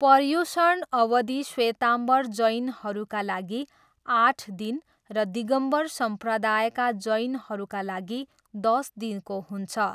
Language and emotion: Nepali, neutral